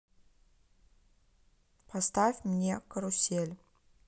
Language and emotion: Russian, neutral